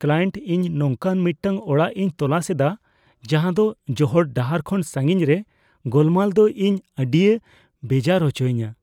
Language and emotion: Santali, fearful